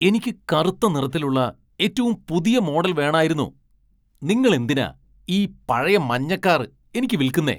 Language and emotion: Malayalam, angry